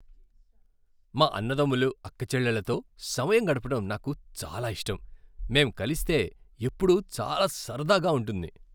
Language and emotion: Telugu, happy